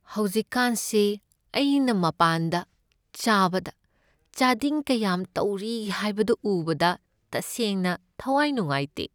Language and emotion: Manipuri, sad